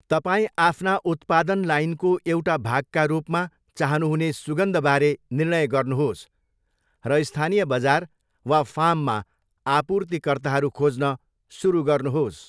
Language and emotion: Nepali, neutral